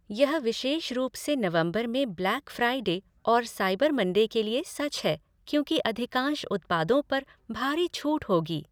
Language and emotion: Hindi, neutral